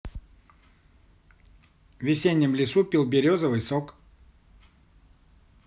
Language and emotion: Russian, neutral